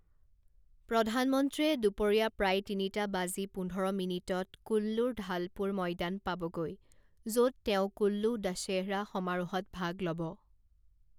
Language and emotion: Assamese, neutral